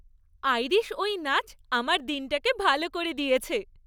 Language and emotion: Bengali, happy